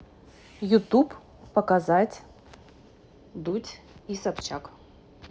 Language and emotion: Russian, neutral